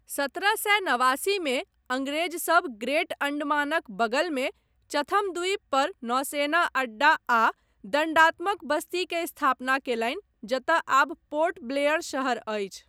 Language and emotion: Maithili, neutral